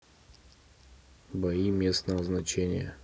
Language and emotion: Russian, neutral